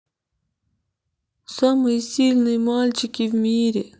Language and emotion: Russian, sad